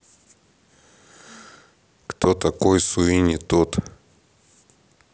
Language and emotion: Russian, neutral